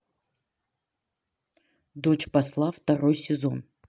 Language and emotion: Russian, neutral